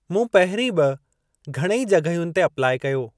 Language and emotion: Sindhi, neutral